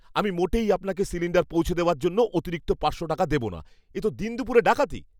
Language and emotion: Bengali, angry